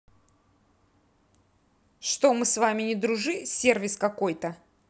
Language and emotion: Russian, angry